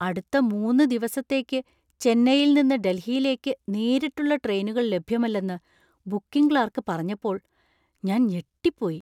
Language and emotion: Malayalam, surprised